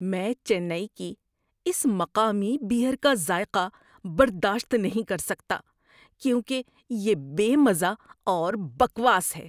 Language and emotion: Urdu, disgusted